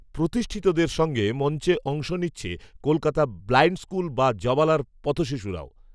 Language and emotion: Bengali, neutral